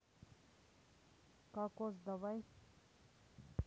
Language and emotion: Russian, neutral